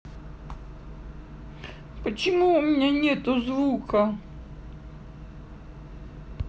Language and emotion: Russian, sad